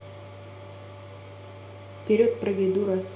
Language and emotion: Russian, neutral